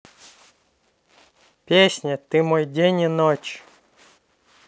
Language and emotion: Russian, neutral